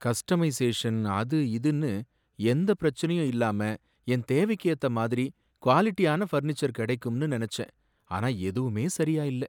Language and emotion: Tamil, sad